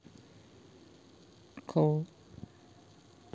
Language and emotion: Russian, neutral